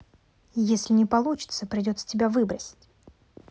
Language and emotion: Russian, angry